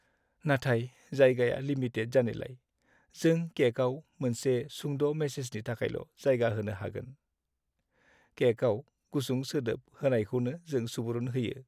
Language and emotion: Bodo, sad